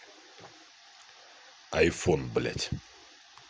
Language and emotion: Russian, angry